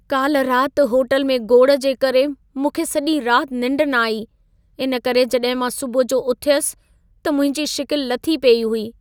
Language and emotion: Sindhi, sad